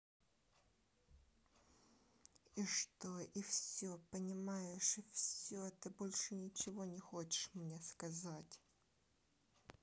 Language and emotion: Russian, angry